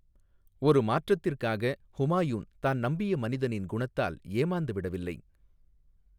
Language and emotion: Tamil, neutral